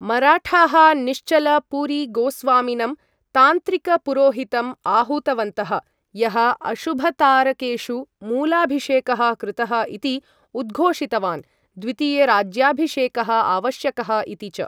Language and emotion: Sanskrit, neutral